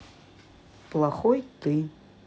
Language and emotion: Russian, neutral